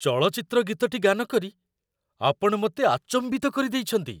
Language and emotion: Odia, surprised